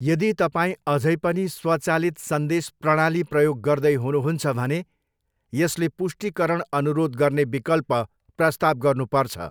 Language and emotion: Nepali, neutral